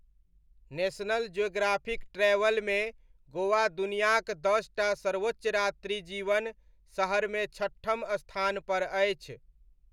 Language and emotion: Maithili, neutral